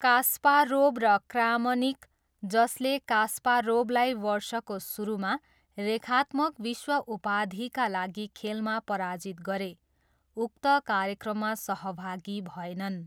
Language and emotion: Nepali, neutral